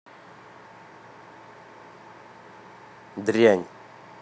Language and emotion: Russian, angry